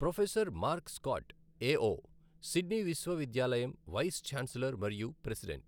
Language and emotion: Telugu, neutral